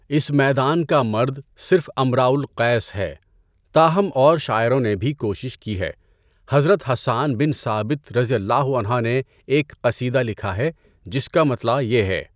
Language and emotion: Urdu, neutral